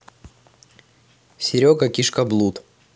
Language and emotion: Russian, neutral